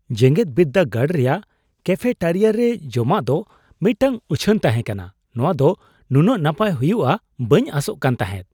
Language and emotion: Santali, surprised